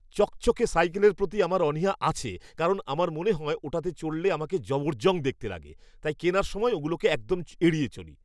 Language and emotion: Bengali, disgusted